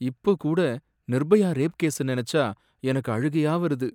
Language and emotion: Tamil, sad